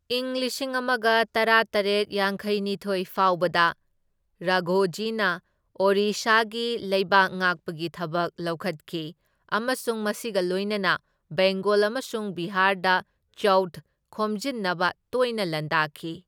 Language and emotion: Manipuri, neutral